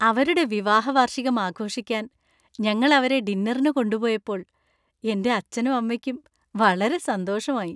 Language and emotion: Malayalam, happy